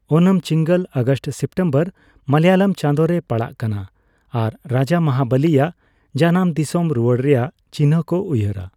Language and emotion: Santali, neutral